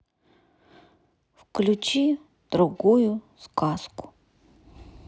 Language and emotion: Russian, neutral